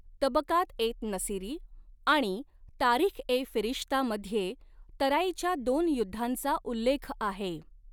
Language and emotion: Marathi, neutral